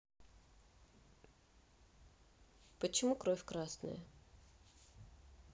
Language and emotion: Russian, neutral